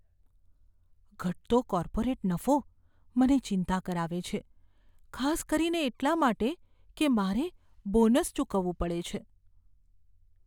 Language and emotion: Gujarati, fearful